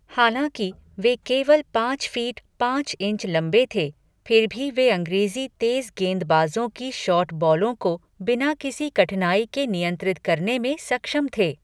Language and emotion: Hindi, neutral